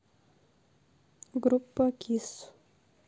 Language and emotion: Russian, neutral